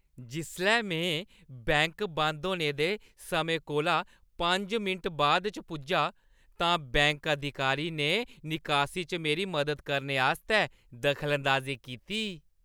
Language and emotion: Dogri, happy